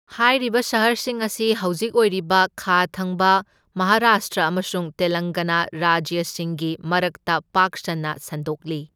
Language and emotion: Manipuri, neutral